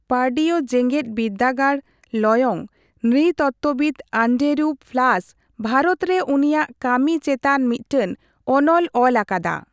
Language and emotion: Santali, neutral